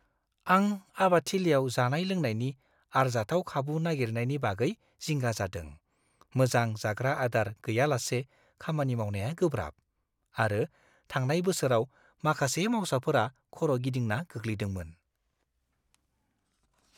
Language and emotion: Bodo, fearful